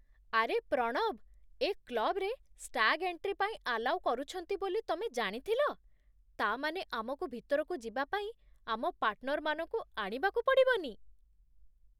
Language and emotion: Odia, surprised